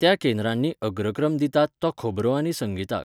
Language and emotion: Goan Konkani, neutral